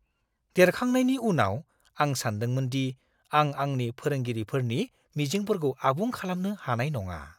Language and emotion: Bodo, fearful